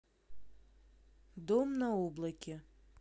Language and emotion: Russian, neutral